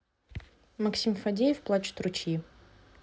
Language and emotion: Russian, neutral